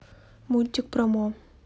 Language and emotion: Russian, neutral